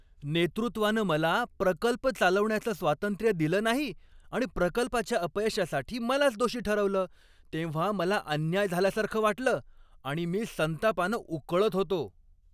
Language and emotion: Marathi, angry